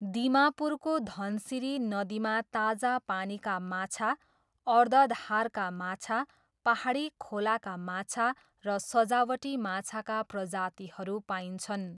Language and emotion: Nepali, neutral